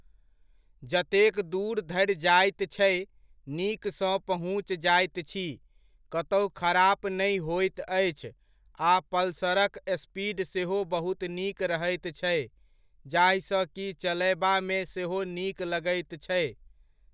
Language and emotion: Maithili, neutral